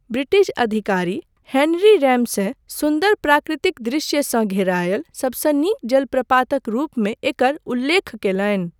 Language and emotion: Maithili, neutral